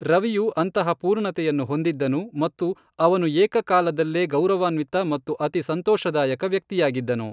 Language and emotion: Kannada, neutral